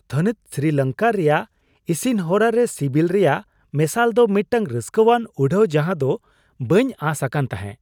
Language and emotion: Santali, surprised